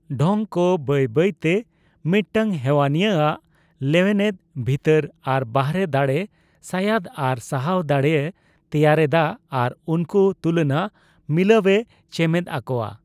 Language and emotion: Santali, neutral